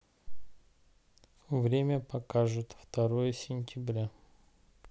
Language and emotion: Russian, neutral